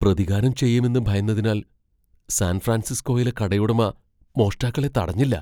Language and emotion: Malayalam, fearful